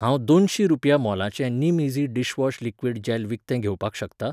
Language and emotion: Goan Konkani, neutral